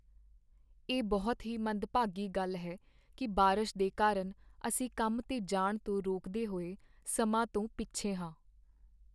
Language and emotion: Punjabi, sad